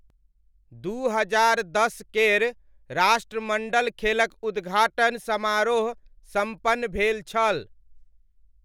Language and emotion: Maithili, neutral